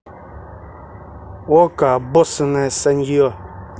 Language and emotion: Russian, angry